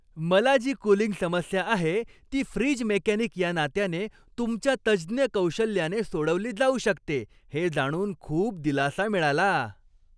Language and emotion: Marathi, happy